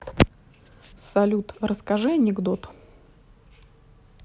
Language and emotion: Russian, neutral